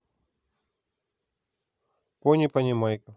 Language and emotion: Russian, neutral